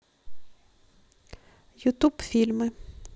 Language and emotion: Russian, neutral